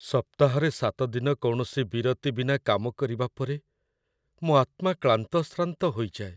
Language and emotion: Odia, sad